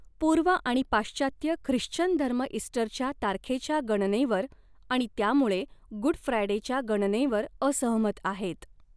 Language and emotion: Marathi, neutral